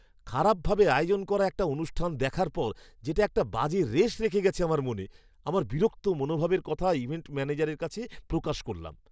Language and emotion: Bengali, disgusted